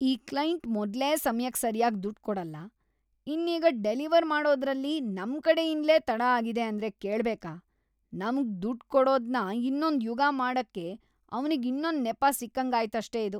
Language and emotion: Kannada, disgusted